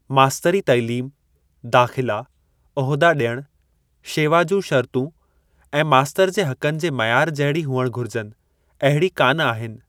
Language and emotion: Sindhi, neutral